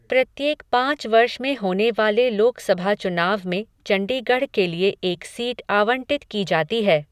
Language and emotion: Hindi, neutral